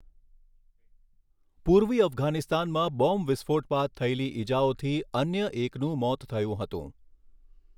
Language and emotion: Gujarati, neutral